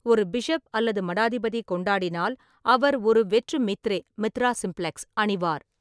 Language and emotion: Tamil, neutral